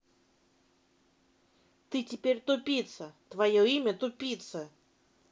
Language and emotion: Russian, angry